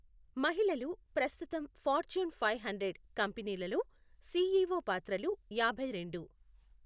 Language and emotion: Telugu, neutral